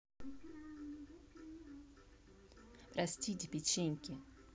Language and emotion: Russian, neutral